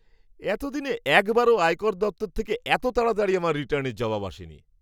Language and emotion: Bengali, surprised